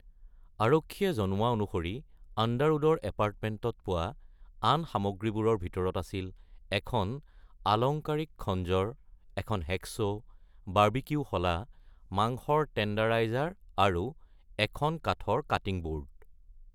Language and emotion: Assamese, neutral